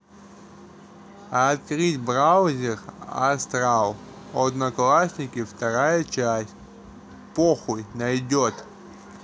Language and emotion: Russian, neutral